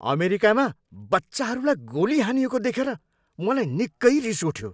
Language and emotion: Nepali, angry